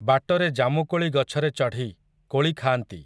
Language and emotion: Odia, neutral